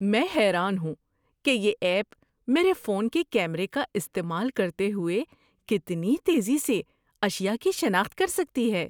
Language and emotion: Urdu, surprised